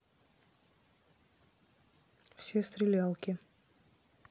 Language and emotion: Russian, neutral